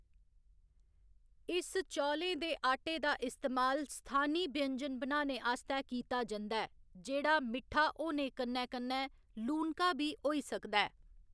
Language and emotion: Dogri, neutral